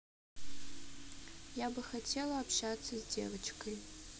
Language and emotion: Russian, sad